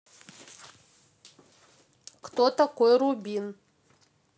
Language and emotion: Russian, neutral